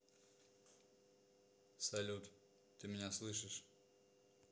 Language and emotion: Russian, neutral